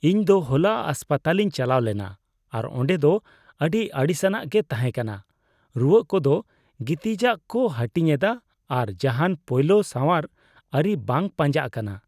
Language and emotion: Santali, disgusted